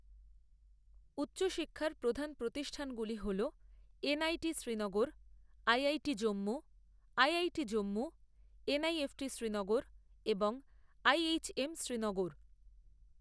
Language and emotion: Bengali, neutral